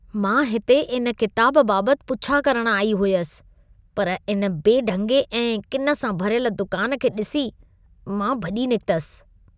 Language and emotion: Sindhi, disgusted